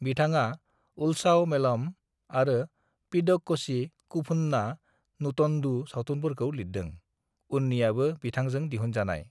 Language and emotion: Bodo, neutral